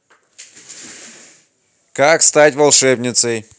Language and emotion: Russian, neutral